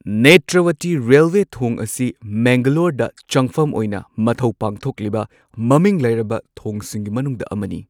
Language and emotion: Manipuri, neutral